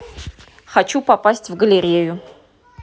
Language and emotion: Russian, neutral